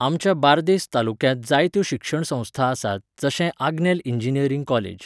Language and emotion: Goan Konkani, neutral